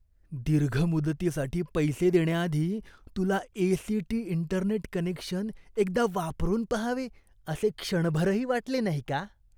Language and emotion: Marathi, disgusted